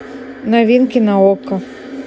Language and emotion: Russian, neutral